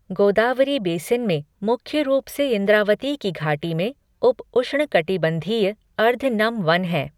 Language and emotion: Hindi, neutral